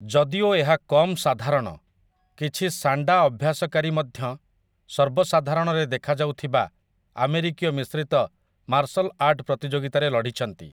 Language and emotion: Odia, neutral